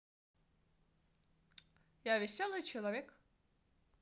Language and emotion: Russian, positive